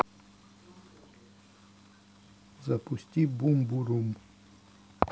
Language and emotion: Russian, neutral